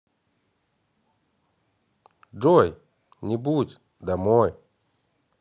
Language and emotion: Russian, positive